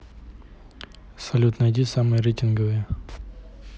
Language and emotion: Russian, neutral